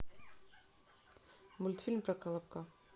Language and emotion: Russian, neutral